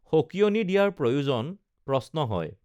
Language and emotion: Assamese, neutral